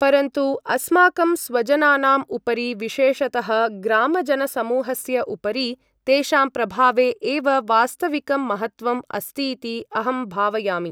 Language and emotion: Sanskrit, neutral